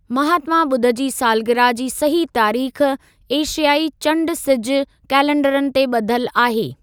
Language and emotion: Sindhi, neutral